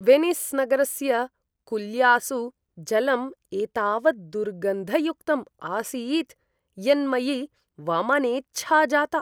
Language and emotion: Sanskrit, disgusted